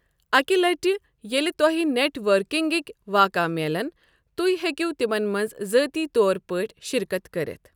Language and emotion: Kashmiri, neutral